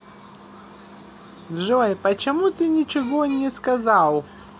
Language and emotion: Russian, positive